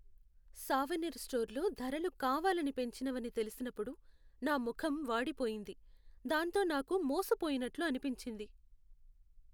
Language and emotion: Telugu, sad